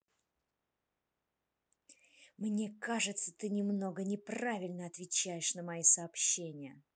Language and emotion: Russian, angry